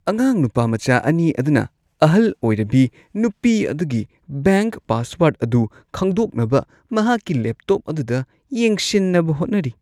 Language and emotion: Manipuri, disgusted